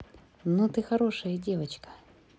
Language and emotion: Russian, positive